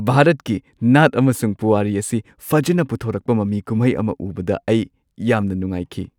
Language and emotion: Manipuri, happy